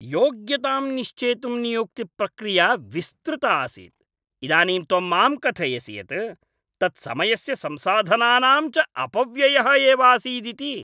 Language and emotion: Sanskrit, angry